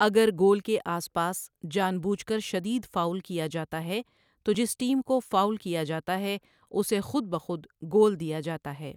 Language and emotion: Urdu, neutral